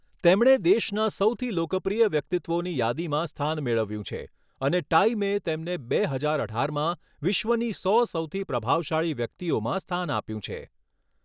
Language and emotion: Gujarati, neutral